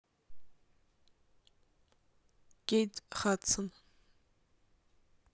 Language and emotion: Russian, neutral